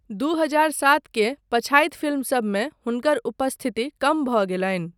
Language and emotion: Maithili, neutral